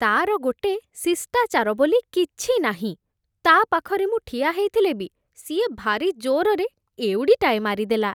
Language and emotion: Odia, disgusted